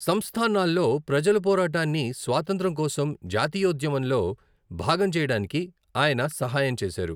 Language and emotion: Telugu, neutral